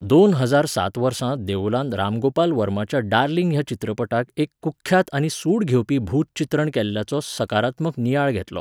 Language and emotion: Goan Konkani, neutral